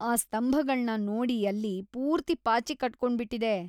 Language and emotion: Kannada, disgusted